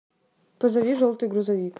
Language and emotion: Russian, neutral